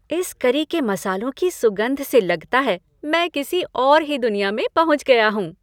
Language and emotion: Hindi, happy